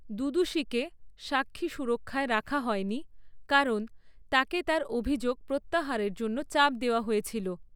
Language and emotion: Bengali, neutral